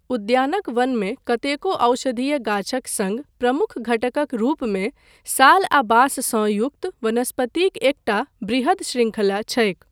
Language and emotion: Maithili, neutral